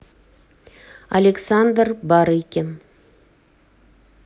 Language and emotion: Russian, neutral